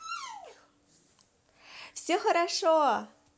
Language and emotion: Russian, positive